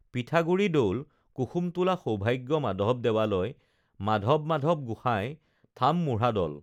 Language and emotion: Assamese, neutral